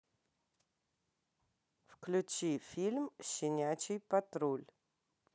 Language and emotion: Russian, neutral